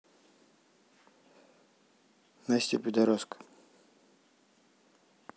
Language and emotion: Russian, neutral